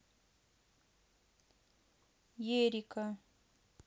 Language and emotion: Russian, neutral